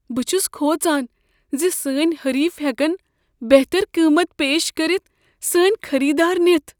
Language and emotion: Kashmiri, fearful